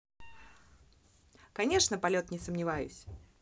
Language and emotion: Russian, positive